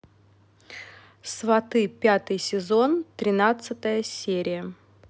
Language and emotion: Russian, neutral